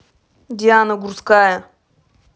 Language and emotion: Russian, angry